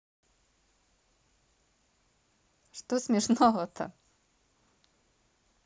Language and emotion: Russian, positive